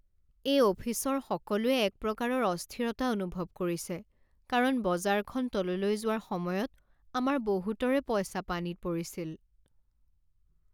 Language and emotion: Assamese, sad